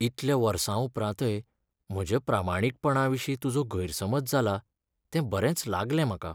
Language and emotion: Goan Konkani, sad